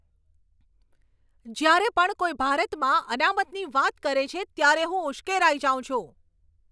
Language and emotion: Gujarati, angry